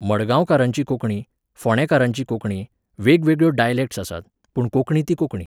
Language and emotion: Goan Konkani, neutral